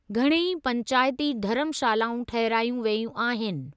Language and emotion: Sindhi, neutral